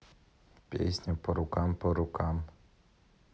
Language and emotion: Russian, neutral